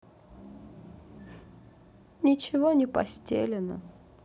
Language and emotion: Russian, sad